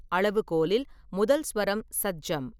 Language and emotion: Tamil, neutral